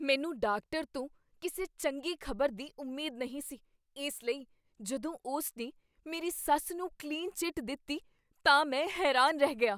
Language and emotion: Punjabi, surprised